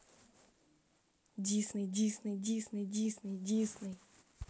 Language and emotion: Russian, neutral